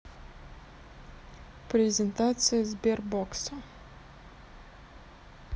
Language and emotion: Russian, neutral